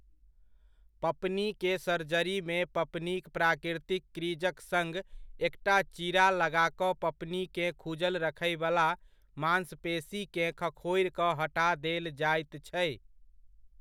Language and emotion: Maithili, neutral